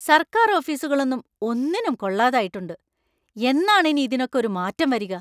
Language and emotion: Malayalam, angry